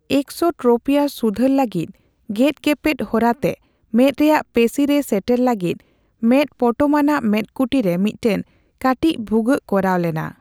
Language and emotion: Santali, neutral